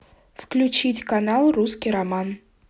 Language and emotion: Russian, neutral